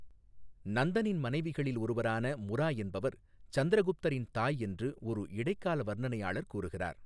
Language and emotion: Tamil, neutral